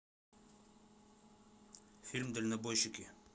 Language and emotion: Russian, neutral